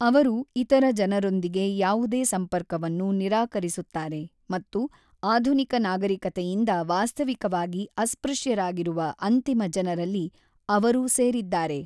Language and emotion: Kannada, neutral